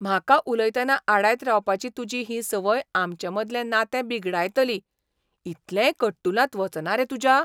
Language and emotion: Goan Konkani, surprised